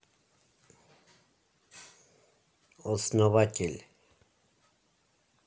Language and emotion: Russian, neutral